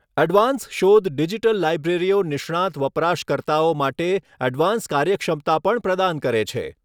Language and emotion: Gujarati, neutral